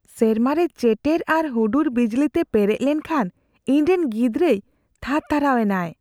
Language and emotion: Santali, fearful